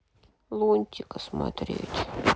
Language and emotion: Russian, sad